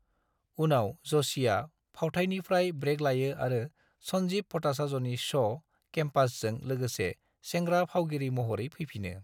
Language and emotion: Bodo, neutral